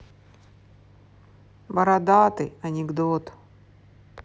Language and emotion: Russian, sad